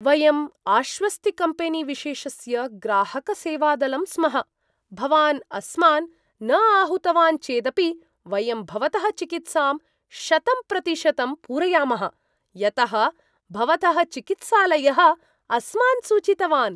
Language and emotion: Sanskrit, surprised